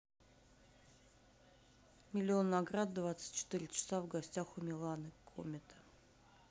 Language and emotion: Russian, neutral